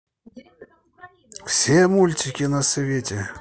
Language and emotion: Russian, positive